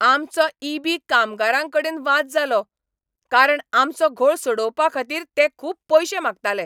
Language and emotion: Goan Konkani, angry